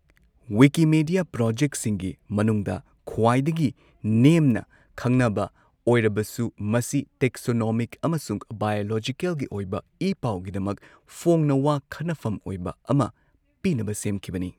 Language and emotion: Manipuri, neutral